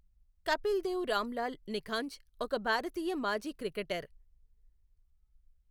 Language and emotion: Telugu, neutral